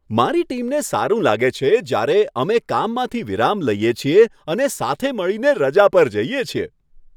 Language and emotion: Gujarati, happy